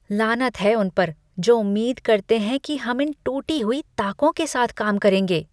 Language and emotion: Hindi, disgusted